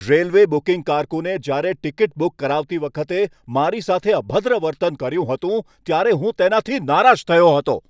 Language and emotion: Gujarati, angry